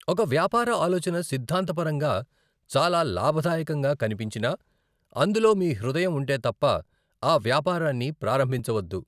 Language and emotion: Telugu, neutral